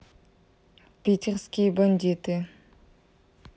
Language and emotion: Russian, neutral